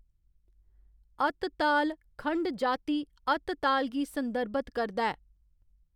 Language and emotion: Dogri, neutral